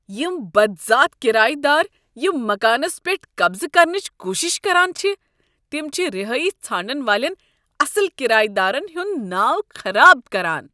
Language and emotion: Kashmiri, disgusted